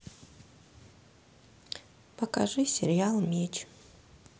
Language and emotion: Russian, neutral